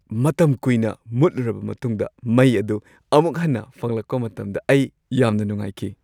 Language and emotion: Manipuri, happy